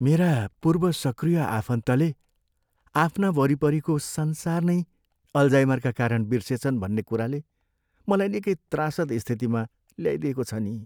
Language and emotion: Nepali, sad